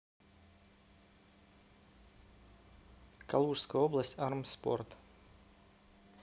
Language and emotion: Russian, neutral